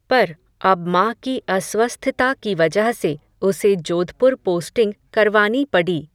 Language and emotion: Hindi, neutral